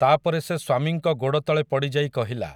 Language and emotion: Odia, neutral